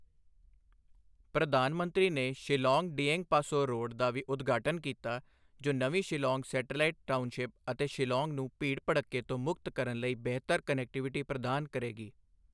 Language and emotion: Punjabi, neutral